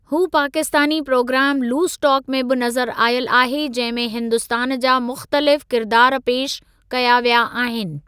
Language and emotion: Sindhi, neutral